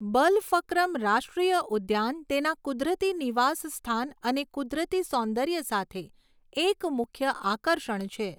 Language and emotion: Gujarati, neutral